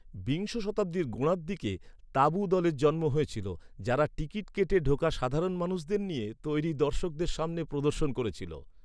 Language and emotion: Bengali, neutral